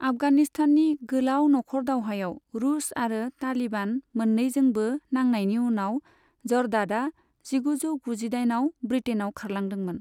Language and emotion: Bodo, neutral